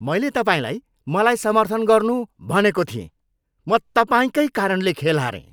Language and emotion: Nepali, angry